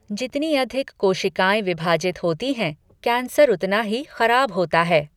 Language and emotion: Hindi, neutral